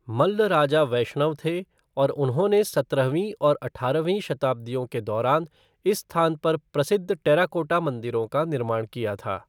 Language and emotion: Hindi, neutral